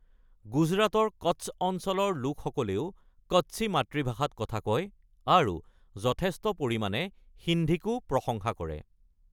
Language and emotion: Assamese, neutral